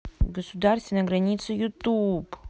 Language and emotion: Russian, neutral